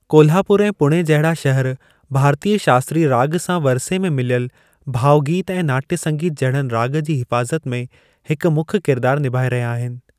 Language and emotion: Sindhi, neutral